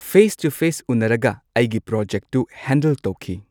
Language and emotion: Manipuri, neutral